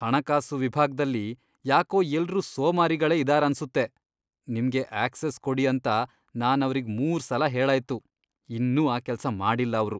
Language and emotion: Kannada, disgusted